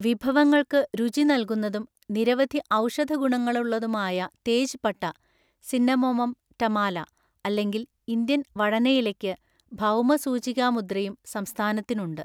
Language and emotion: Malayalam, neutral